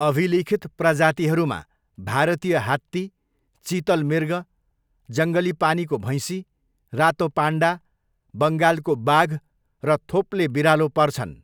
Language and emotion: Nepali, neutral